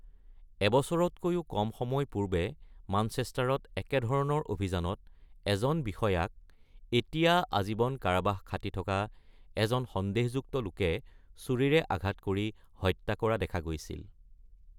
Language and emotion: Assamese, neutral